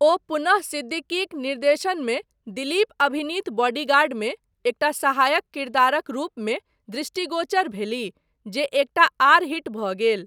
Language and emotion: Maithili, neutral